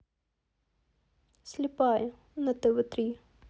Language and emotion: Russian, neutral